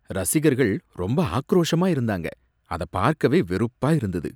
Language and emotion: Tamil, disgusted